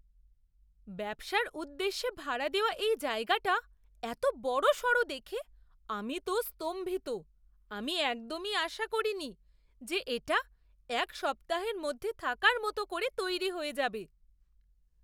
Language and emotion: Bengali, surprised